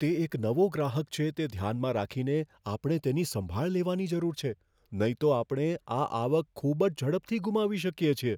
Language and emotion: Gujarati, fearful